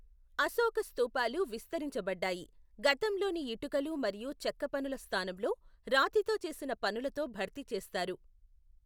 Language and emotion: Telugu, neutral